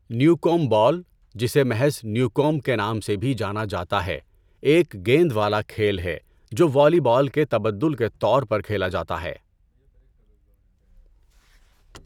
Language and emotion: Urdu, neutral